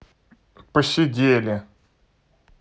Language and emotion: Russian, neutral